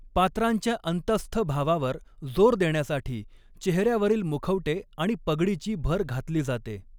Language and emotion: Marathi, neutral